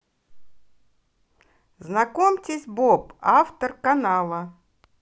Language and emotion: Russian, positive